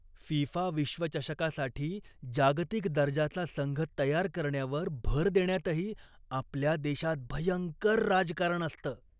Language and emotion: Marathi, disgusted